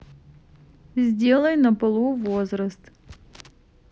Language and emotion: Russian, neutral